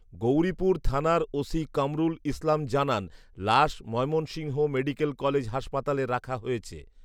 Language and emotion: Bengali, neutral